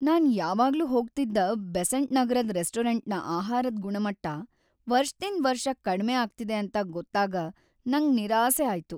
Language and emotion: Kannada, sad